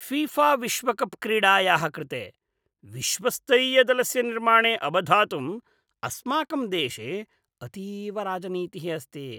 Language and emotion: Sanskrit, disgusted